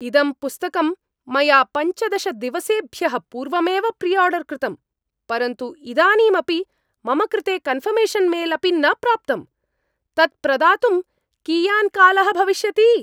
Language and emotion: Sanskrit, angry